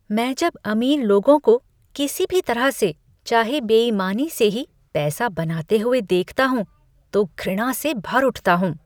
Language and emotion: Hindi, disgusted